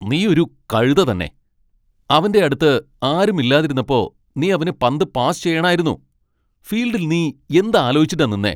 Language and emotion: Malayalam, angry